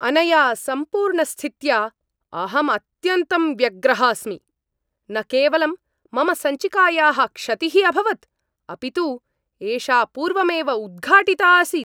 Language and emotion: Sanskrit, angry